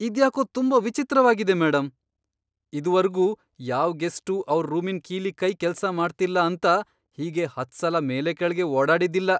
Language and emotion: Kannada, surprised